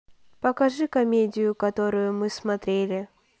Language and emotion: Russian, neutral